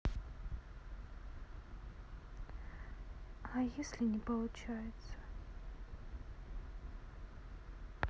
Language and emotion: Russian, sad